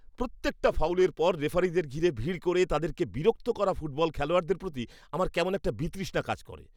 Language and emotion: Bengali, disgusted